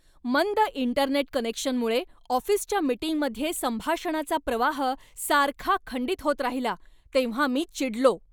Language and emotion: Marathi, angry